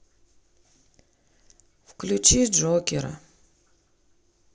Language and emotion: Russian, sad